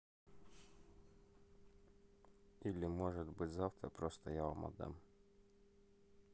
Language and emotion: Russian, neutral